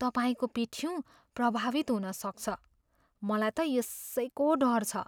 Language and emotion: Nepali, fearful